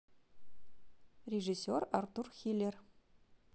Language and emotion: Russian, neutral